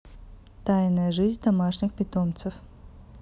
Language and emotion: Russian, neutral